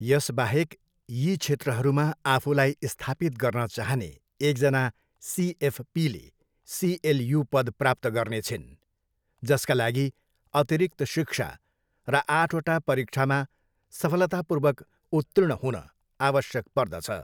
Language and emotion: Nepali, neutral